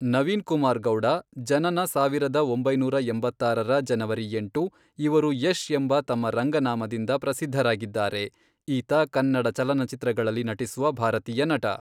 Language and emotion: Kannada, neutral